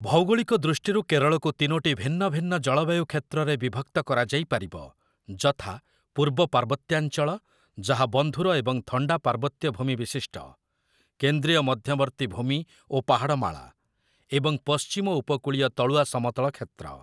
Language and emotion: Odia, neutral